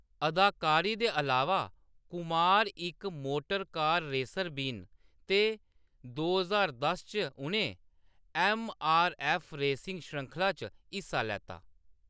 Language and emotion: Dogri, neutral